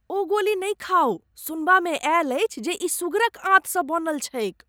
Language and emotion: Maithili, disgusted